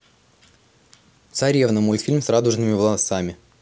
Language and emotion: Russian, neutral